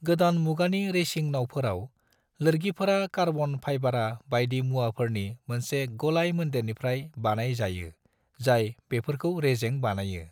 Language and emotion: Bodo, neutral